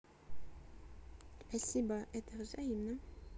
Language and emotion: Russian, neutral